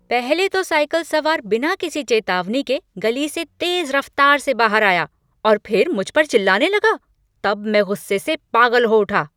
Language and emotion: Hindi, angry